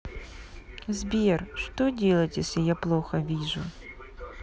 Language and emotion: Russian, sad